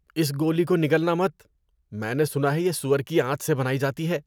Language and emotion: Urdu, disgusted